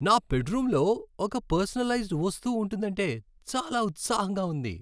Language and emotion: Telugu, happy